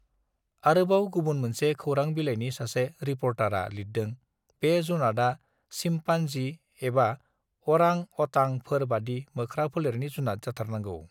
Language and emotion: Bodo, neutral